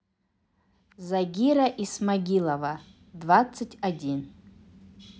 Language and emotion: Russian, neutral